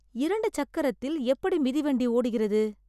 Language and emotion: Tamil, surprised